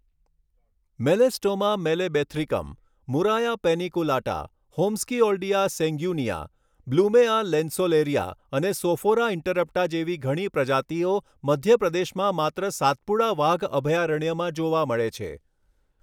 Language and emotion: Gujarati, neutral